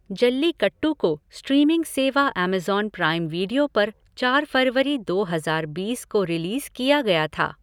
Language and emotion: Hindi, neutral